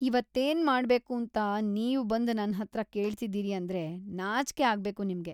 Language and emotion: Kannada, disgusted